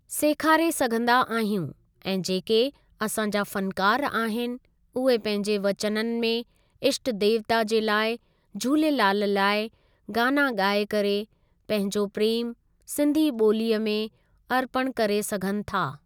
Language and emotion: Sindhi, neutral